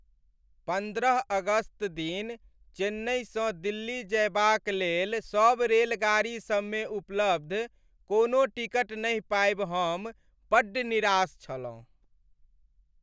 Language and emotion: Maithili, sad